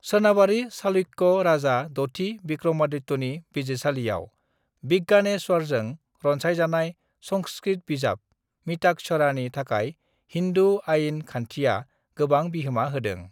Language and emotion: Bodo, neutral